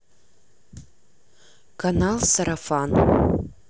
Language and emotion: Russian, neutral